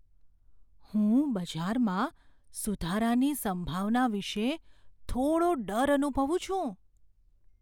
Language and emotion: Gujarati, fearful